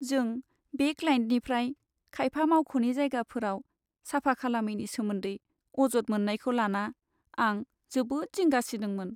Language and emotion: Bodo, sad